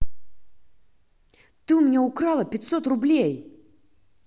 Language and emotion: Russian, angry